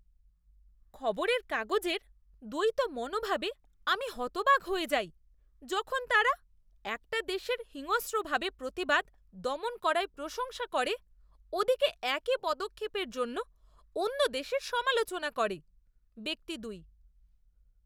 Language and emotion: Bengali, disgusted